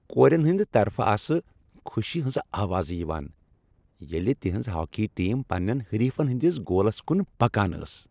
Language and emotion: Kashmiri, happy